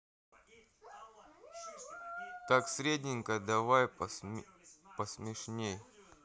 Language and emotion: Russian, sad